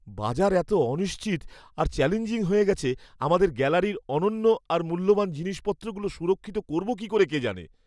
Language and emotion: Bengali, fearful